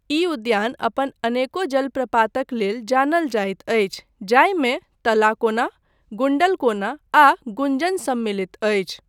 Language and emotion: Maithili, neutral